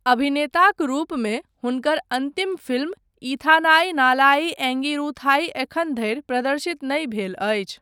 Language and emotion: Maithili, neutral